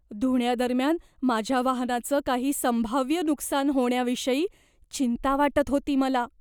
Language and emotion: Marathi, fearful